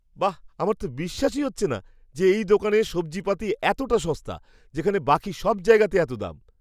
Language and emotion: Bengali, surprised